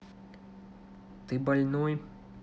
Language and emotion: Russian, neutral